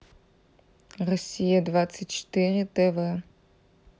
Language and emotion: Russian, neutral